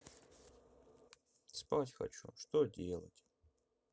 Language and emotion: Russian, sad